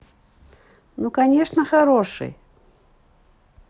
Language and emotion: Russian, positive